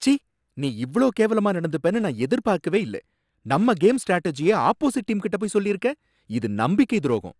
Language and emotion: Tamil, angry